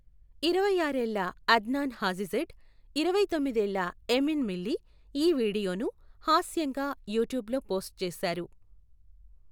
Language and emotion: Telugu, neutral